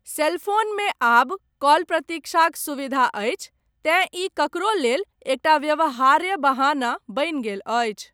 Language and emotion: Maithili, neutral